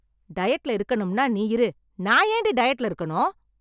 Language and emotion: Tamil, angry